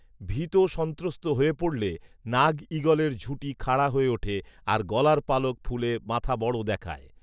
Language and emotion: Bengali, neutral